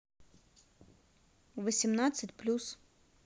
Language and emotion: Russian, neutral